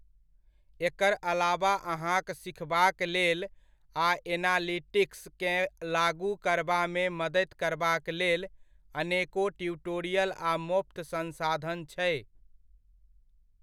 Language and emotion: Maithili, neutral